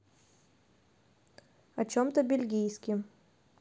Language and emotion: Russian, neutral